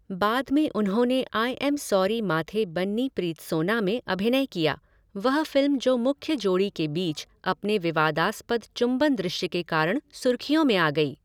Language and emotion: Hindi, neutral